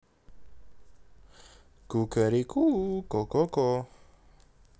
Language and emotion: Russian, positive